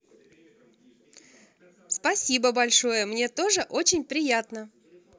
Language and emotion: Russian, positive